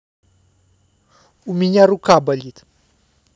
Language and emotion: Russian, neutral